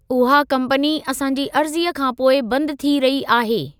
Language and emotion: Sindhi, neutral